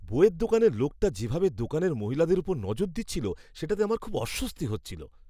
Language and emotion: Bengali, disgusted